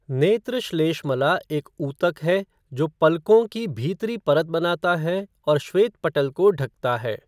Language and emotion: Hindi, neutral